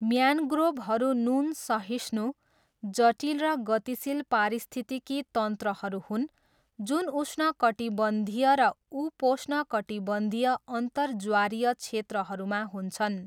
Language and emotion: Nepali, neutral